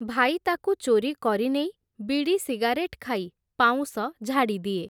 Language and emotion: Odia, neutral